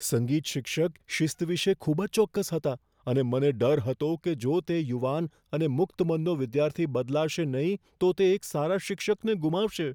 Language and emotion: Gujarati, fearful